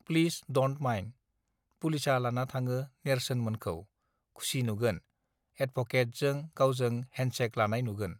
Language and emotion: Bodo, neutral